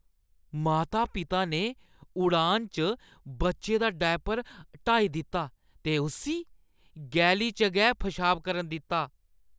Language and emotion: Dogri, disgusted